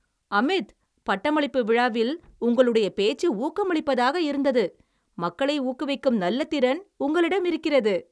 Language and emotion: Tamil, happy